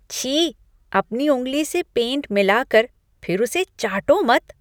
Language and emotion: Hindi, disgusted